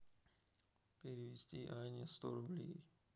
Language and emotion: Russian, sad